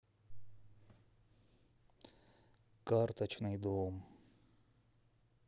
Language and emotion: Russian, sad